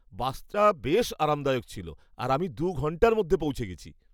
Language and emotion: Bengali, happy